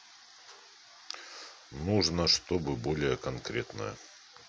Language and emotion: Russian, neutral